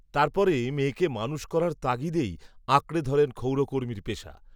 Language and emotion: Bengali, neutral